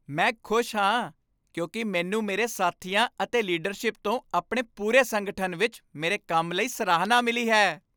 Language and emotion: Punjabi, happy